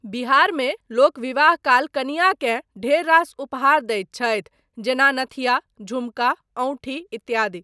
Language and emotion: Maithili, neutral